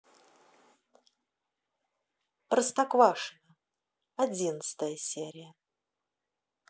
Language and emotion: Russian, neutral